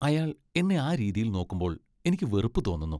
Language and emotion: Malayalam, disgusted